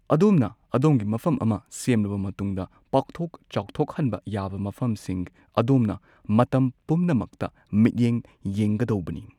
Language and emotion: Manipuri, neutral